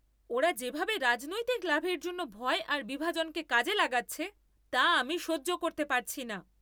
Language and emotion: Bengali, angry